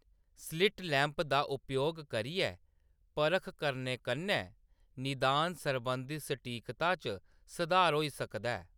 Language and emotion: Dogri, neutral